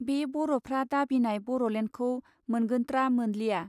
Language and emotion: Bodo, neutral